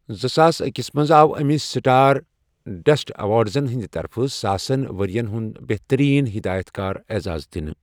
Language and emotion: Kashmiri, neutral